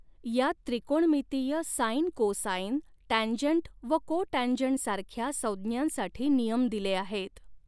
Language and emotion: Marathi, neutral